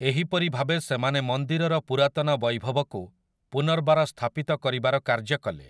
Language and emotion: Odia, neutral